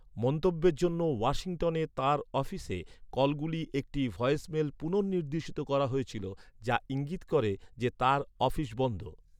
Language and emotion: Bengali, neutral